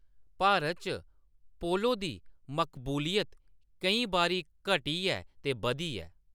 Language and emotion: Dogri, neutral